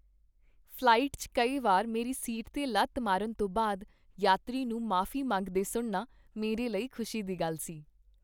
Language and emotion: Punjabi, happy